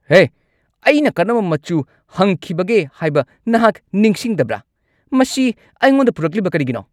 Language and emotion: Manipuri, angry